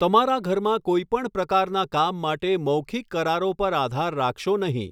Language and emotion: Gujarati, neutral